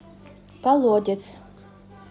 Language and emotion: Russian, neutral